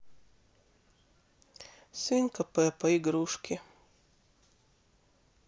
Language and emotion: Russian, sad